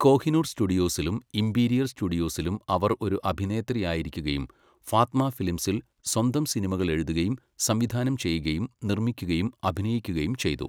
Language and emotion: Malayalam, neutral